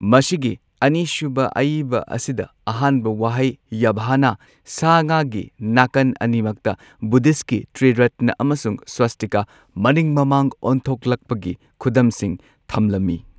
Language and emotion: Manipuri, neutral